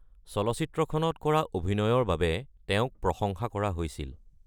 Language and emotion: Assamese, neutral